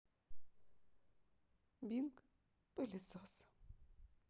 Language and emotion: Russian, sad